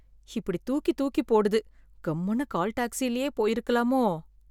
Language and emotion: Tamil, fearful